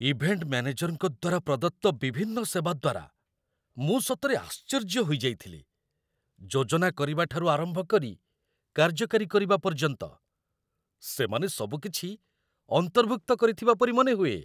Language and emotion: Odia, surprised